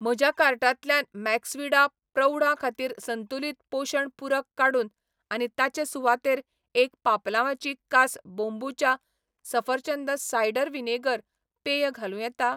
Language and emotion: Goan Konkani, neutral